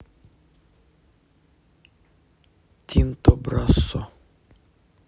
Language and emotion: Russian, neutral